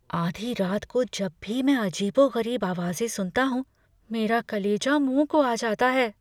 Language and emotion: Hindi, fearful